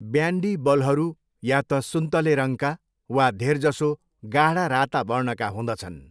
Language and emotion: Nepali, neutral